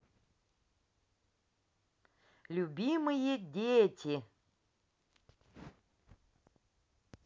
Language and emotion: Russian, positive